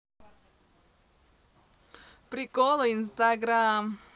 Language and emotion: Russian, positive